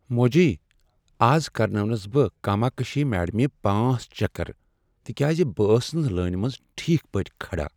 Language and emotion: Kashmiri, sad